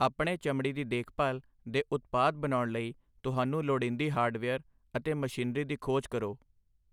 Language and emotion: Punjabi, neutral